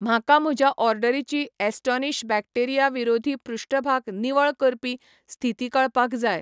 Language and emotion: Goan Konkani, neutral